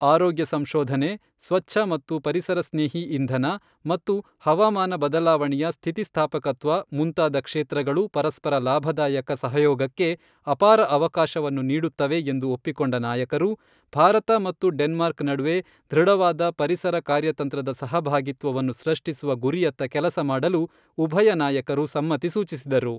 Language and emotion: Kannada, neutral